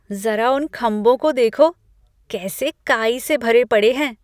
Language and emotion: Hindi, disgusted